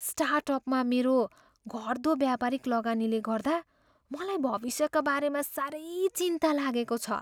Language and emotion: Nepali, fearful